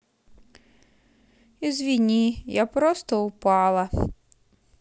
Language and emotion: Russian, sad